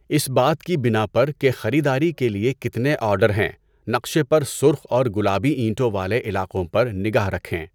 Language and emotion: Urdu, neutral